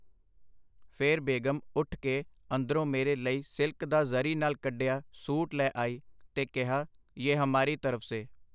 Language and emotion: Punjabi, neutral